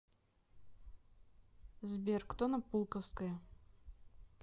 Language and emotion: Russian, neutral